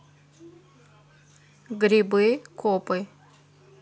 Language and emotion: Russian, neutral